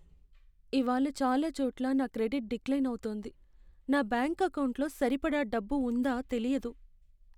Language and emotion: Telugu, sad